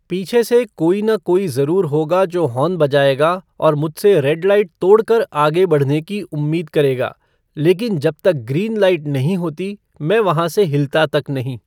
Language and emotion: Hindi, neutral